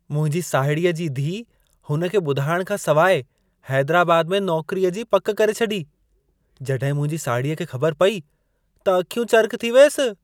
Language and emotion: Sindhi, surprised